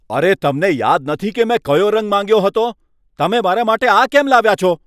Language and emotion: Gujarati, angry